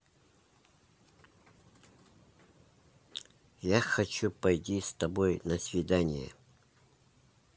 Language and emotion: Russian, neutral